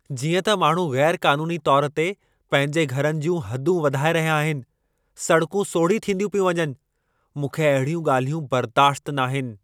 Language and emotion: Sindhi, angry